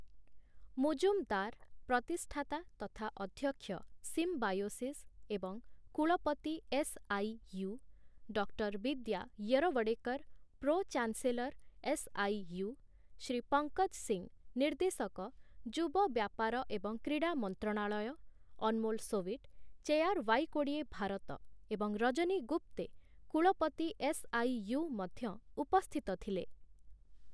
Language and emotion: Odia, neutral